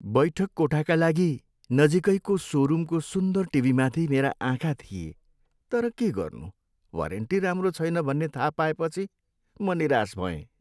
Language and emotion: Nepali, sad